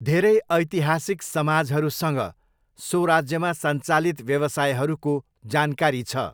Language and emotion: Nepali, neutral